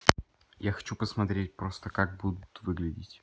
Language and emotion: Russian, neutral